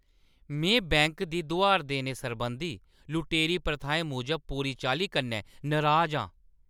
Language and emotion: Dogri, angry